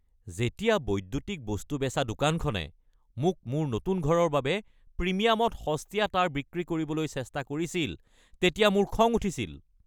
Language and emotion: Assamese, angry